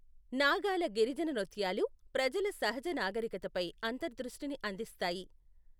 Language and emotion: Telugu, neutral